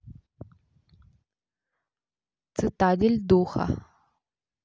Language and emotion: Russian, neutral